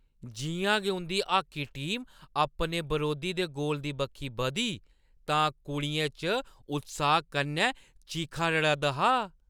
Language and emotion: Dogri, happy